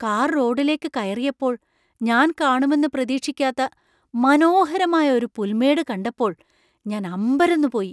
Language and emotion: Malayalam, surprised